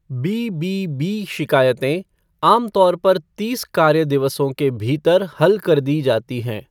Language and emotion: Hindi, neutral